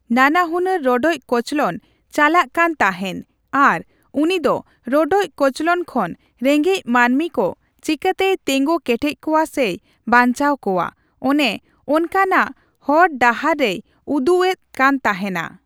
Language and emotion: Santali, neutral